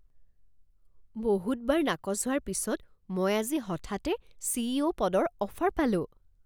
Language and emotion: Assamese, surprised